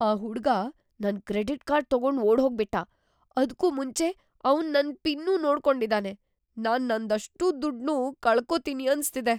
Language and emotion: Kannada, fearful